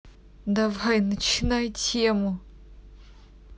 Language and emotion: Russian, positive